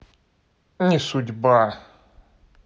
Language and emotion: Russian, neutral